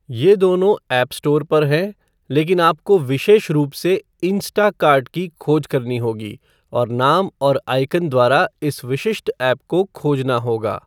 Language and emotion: Hindi, neutral